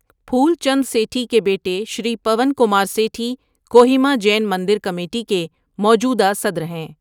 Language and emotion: Urdu, neutral